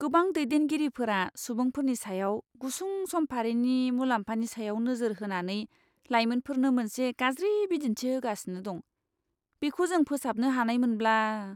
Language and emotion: Bodo, disgusted